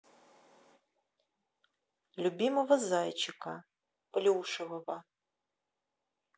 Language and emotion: Russian, neutral